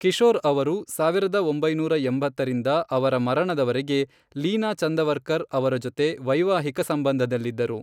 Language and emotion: Kannada, neutral